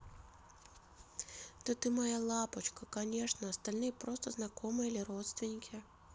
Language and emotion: Russian, positive